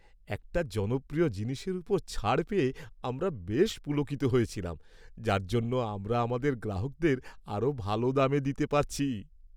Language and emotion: Bengali, happy